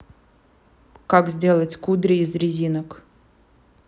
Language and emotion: Russian, neutral